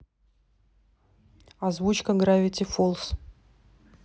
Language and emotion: Russian, neutral